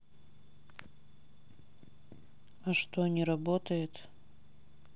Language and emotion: Russian, sad